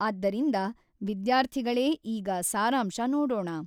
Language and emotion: Kannada, neutral